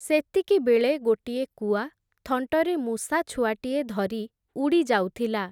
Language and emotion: Odia, neutral